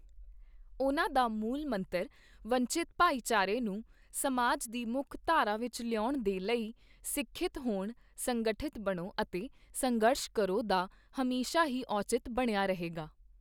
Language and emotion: Punjabi, neutral